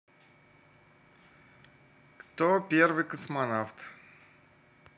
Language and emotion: Russian, neutral